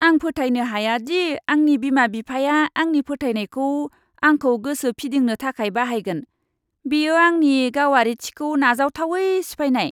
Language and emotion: Bodo, disgusted